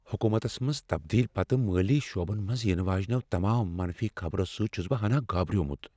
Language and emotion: Kashmiri, fearful